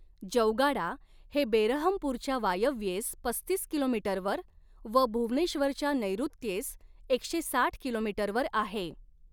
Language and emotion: Marathi, neutral